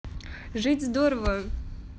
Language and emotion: Russian, positive